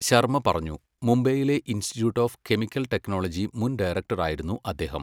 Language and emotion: Malayalam, neutral